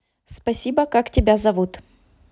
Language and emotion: Russian, neutral